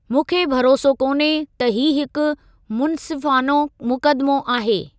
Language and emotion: Sindhi, neutral